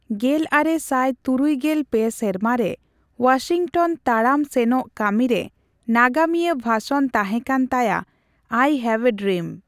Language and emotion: Santali, neutral